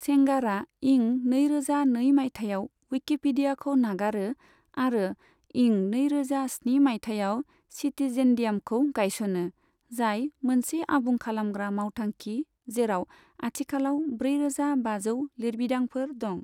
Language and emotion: Bodo, neutral